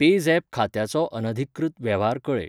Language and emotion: Goan Konkani, neutral